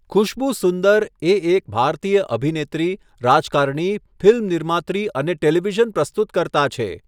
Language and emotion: Gujarati, neutral